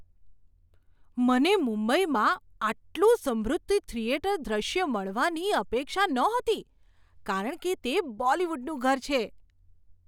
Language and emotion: Gujarati, surprised